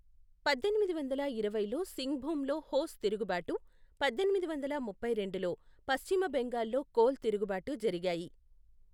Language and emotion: Telugu, neutral